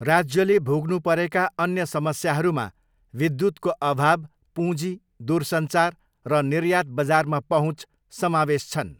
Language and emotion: Nepali, neutral